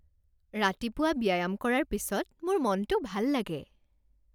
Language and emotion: Assamese, happy